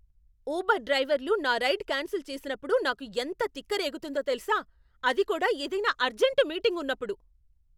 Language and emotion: Telugu, angry